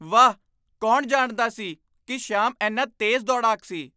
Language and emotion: Punjabi, surprised